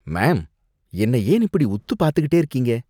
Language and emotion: Tamil, disgusted